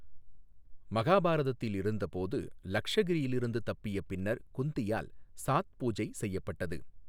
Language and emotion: Tamil, neutral